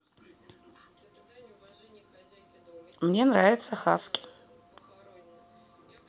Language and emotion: Russian, neutral